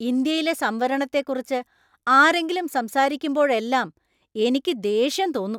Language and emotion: Malayalam, angry